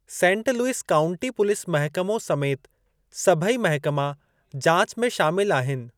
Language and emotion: Sindhi, neutral